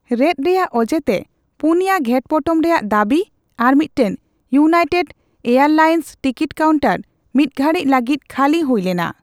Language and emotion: Santali, neutral